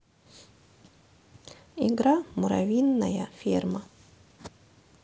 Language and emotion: Russian, neutral